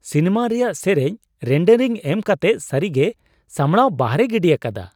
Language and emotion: Santali, surprised